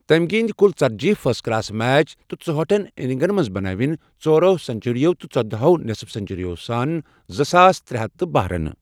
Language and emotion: Kashmiri, neutral